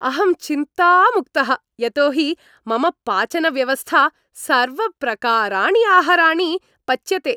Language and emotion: Sanskrit, happy